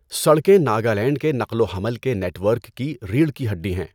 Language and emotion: Urdu, neutral